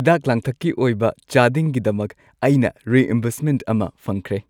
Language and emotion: Manipuri, happy